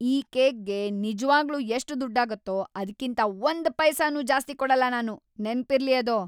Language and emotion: Kannada, angry